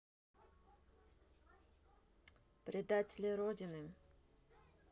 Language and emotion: Russian, neutral